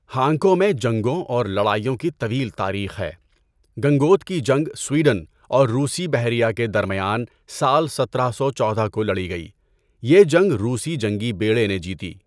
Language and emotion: Urdu, neutral